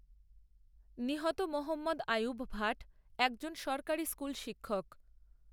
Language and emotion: Bengali, neutral